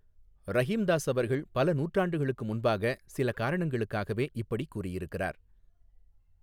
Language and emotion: Tamil, neutral